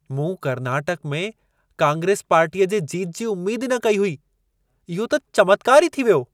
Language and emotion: Sindhi, surprised